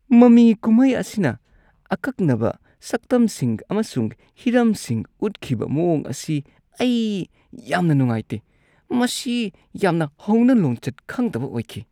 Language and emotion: Manipuri, disgusted